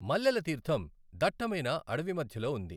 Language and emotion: Telugu, neutral